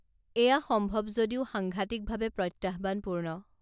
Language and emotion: Assamese, neutral